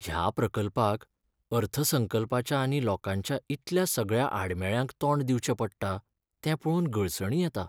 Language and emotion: Goan Konkani, sad